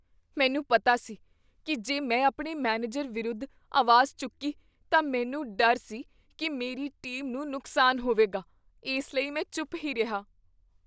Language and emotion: Punjabi, fearful